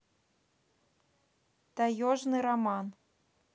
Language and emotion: Russian, neutral